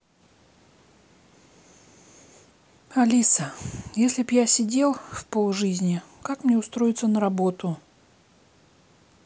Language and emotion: Russian, sad